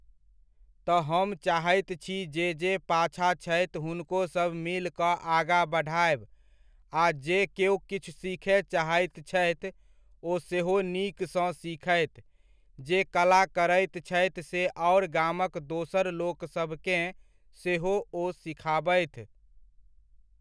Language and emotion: Maithili, neutral